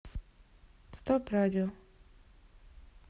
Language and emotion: Russian, neutral